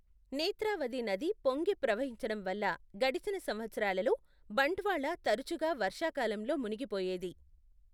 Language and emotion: Telugu, neutral